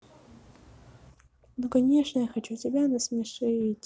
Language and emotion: Russian, sad